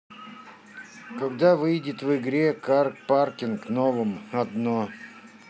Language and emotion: Russian, neutral